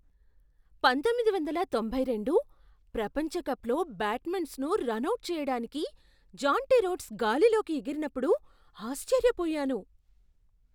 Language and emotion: Telugu, surprised